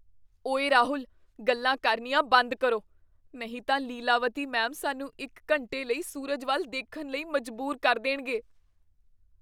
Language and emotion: Punjabi, fearful